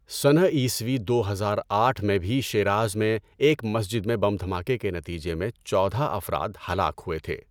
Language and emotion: Urdu, neutral